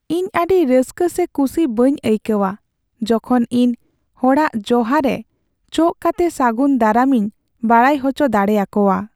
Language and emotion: Santali, sad